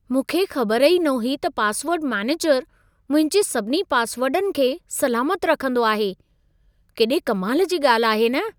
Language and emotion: Sindhi, surprised